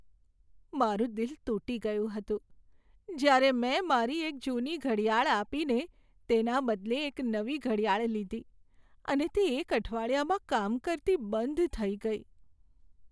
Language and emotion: Gujarati, sad